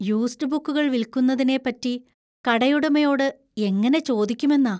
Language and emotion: Malayalam, fearful